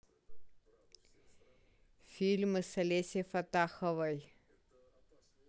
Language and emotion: Russian, neutral